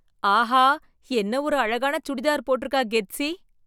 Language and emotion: Tamil, surprised